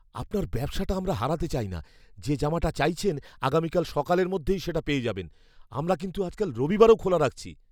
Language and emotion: Bengali, fearful